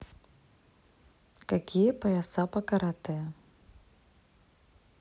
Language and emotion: Russian, neutral